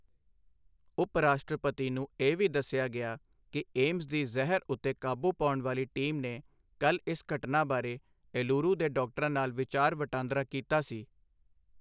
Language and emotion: Punjabi, neutral